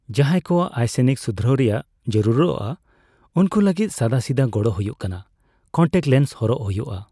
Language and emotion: Santali, neutral